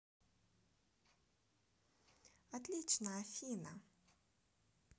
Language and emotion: Russian, positive